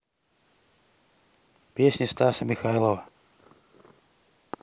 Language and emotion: Russian, neutral